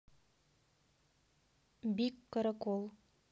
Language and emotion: Russian, neutral